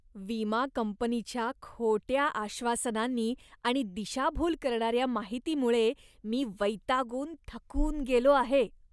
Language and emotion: Marathi, disgusted